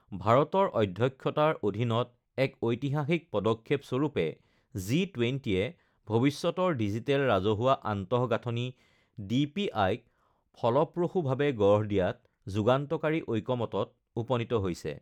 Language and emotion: Assamese, neutral